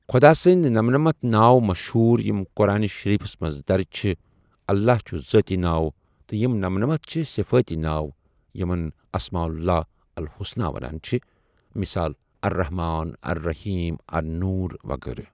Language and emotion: Kashmiri, neutral